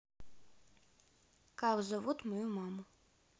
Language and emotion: Russian, neutral